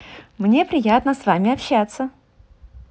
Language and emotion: Russian, positive